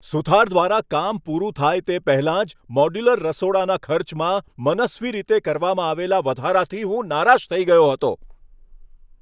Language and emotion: Gujarati, angry